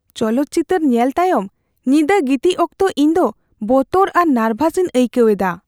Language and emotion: Santali, fearful